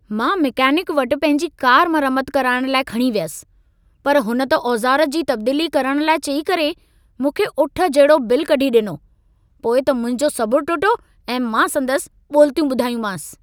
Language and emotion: Sindhi, angry